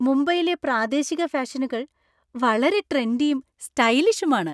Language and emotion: Malayalam, happy